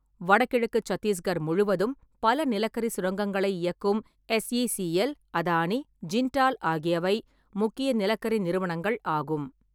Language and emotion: Tamil, neutral